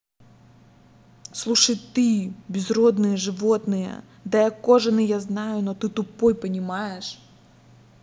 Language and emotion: Russian, angry